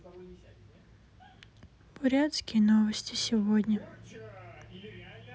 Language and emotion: Russian, sad